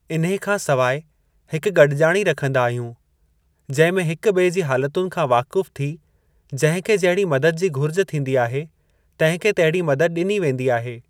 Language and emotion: Sindhi, neutral